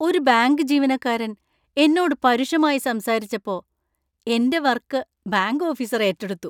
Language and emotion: Malayalam, happy